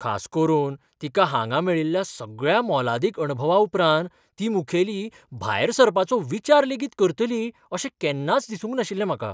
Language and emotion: Goan Konkani, surprised